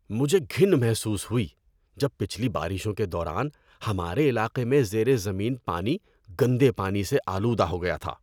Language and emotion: Urdu, disgusted